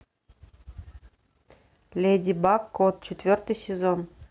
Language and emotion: Russian, neutral